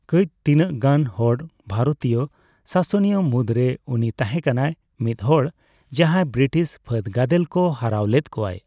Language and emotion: Santali, neutral